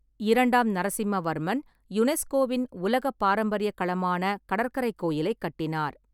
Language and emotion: Tamil, neutral